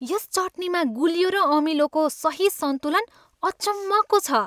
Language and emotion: Nepali, happy